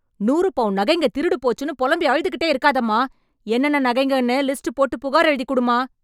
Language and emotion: Tamil, angry